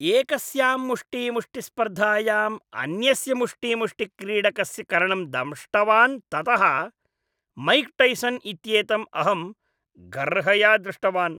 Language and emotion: Sanskrit, disgusted